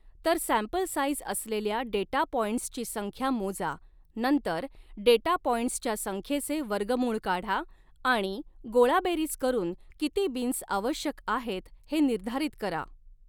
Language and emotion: Marathi, neutral